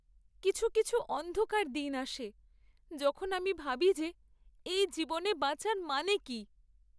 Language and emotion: Bengali, sad